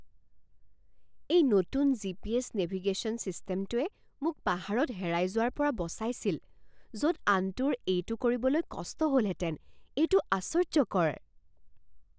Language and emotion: Assamese, surprised